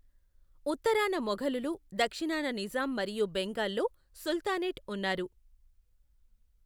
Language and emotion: Telugu, neutral